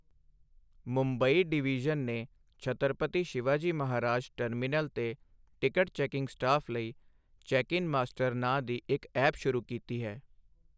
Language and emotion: Punjabi, neutral